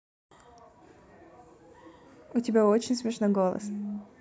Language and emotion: Russian, neutral